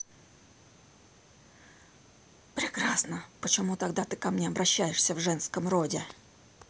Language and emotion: Russian, angry